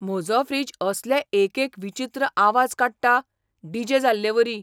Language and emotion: Goan Konkani, surprised